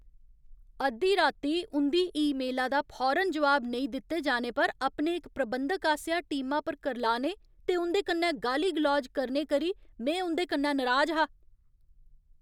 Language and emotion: Dogri, angry